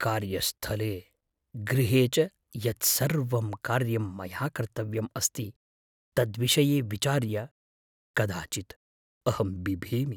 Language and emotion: Sanskrit, fearful